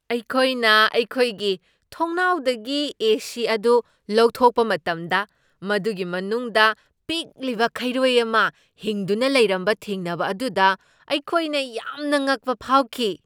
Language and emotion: Manipuri, surprised